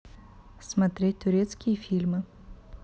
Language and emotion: Russian, neutral